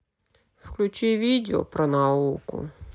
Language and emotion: Russian, sad